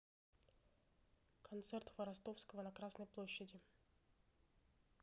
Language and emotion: Russian, neutral